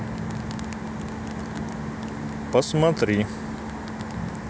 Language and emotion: Russian, neutral